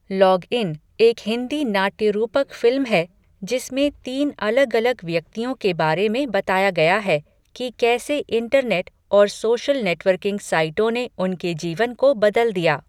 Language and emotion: Hindi, neutral